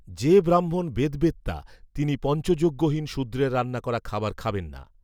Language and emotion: Bengali, neutral